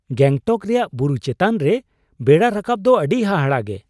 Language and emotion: Santali, surprised